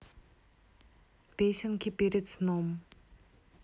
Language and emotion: Russian, neutral